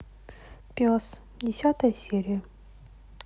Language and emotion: Russian, neutral